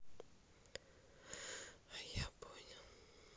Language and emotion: Russian, sad